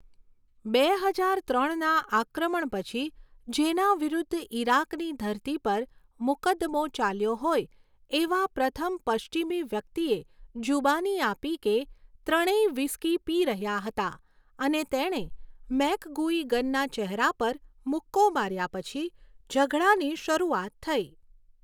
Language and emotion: Gujarati, neutral